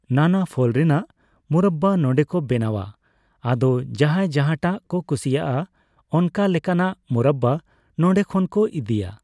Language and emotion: Santali, neutral